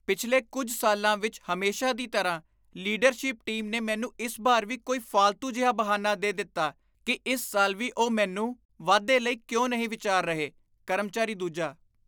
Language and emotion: Punjabi, disgusted